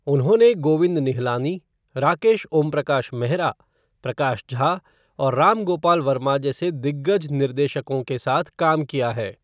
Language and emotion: Hindi, neutral